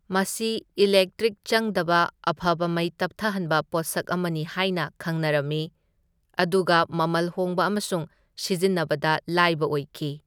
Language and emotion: Manipuri, neutral